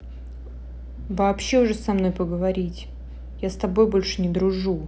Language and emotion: Russian, angry